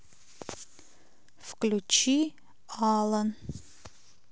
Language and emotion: Russian, neutral